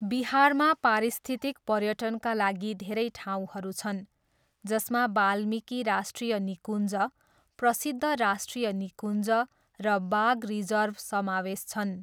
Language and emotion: Nepali, neutral